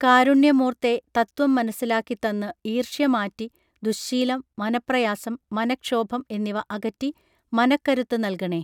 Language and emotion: Malayalam, neutral